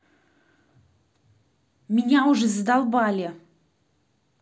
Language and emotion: Russian, angry